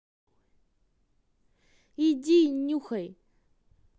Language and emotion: Russian, angry